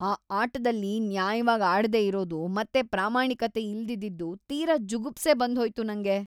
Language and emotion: Kannada, disgusted